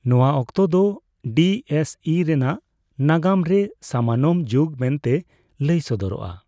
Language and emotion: Santali, neutral